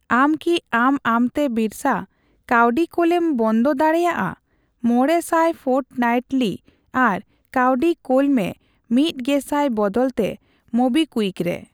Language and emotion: Santali, neutral